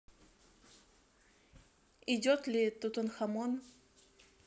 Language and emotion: Russian, neutral